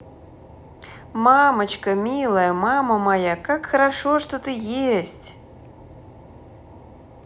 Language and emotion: Russian, positive